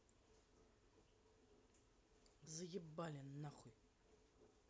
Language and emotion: Russian, angry